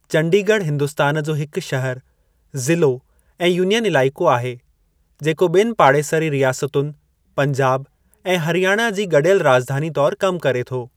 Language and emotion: Sindhi, neutral